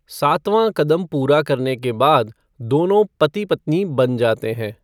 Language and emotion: Hindi, neutral